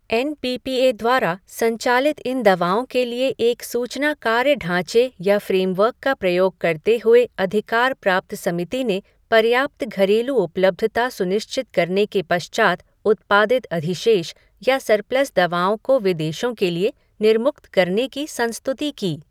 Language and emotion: Hindi, neutral